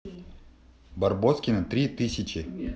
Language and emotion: Russian, positive